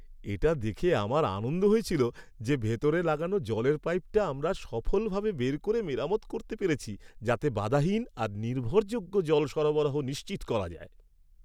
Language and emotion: Bengali, happy